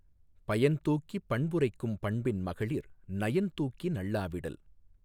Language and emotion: Tamil, neutral